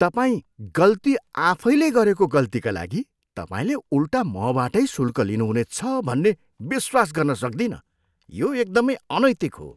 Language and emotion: Nepali, disgusted